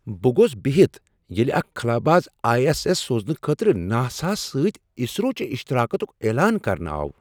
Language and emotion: Kashmiri, surprised